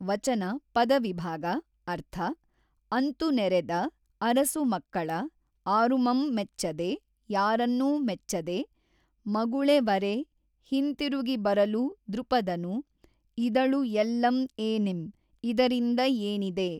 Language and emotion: Kannada, neutral